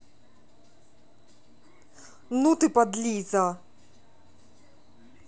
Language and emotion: Russian, angry